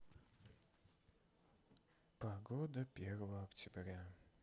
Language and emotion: Russian, sad